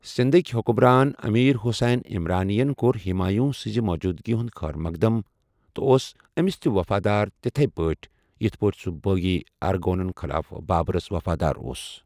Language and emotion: Kashmiri, neutral